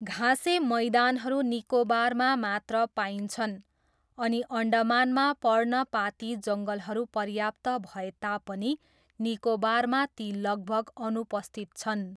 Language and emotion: Nepali, neutral